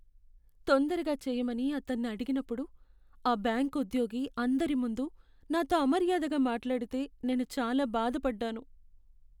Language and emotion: Telugu, sad